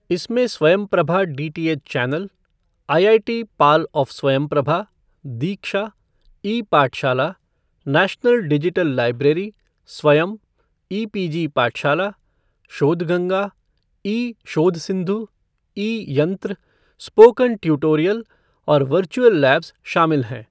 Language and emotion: Hindi, neutral